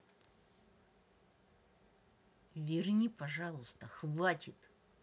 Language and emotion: Russian, angry